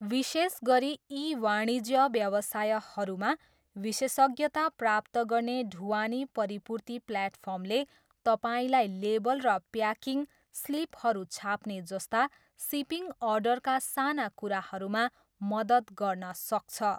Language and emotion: Nepali, neutral